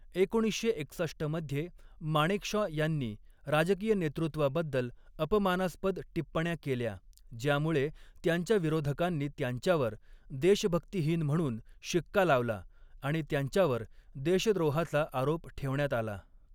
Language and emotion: Marathi, neutral